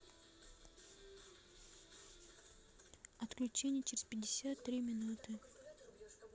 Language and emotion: Russian, neutral